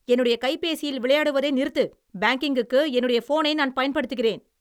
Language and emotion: Tamil, angry